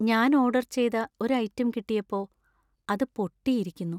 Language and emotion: Malayalam, sad